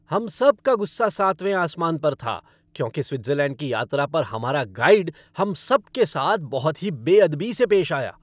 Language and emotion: Hindi, angry